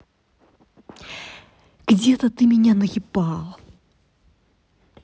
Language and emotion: Russian, angry